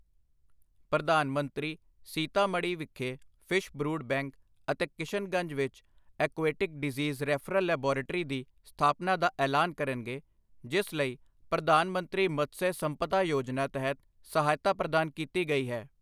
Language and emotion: Punjabi, neutral